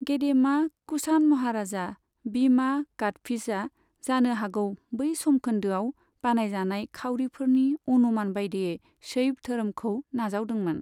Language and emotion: Bodo, neutral